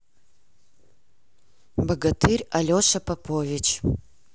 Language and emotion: Russian, neutral